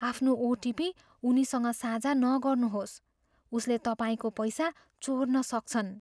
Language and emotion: Nepali, fearful